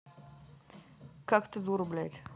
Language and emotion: Russian, angry